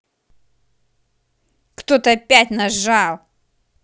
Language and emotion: Russian, angry